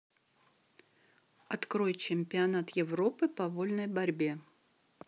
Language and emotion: Russian, neutral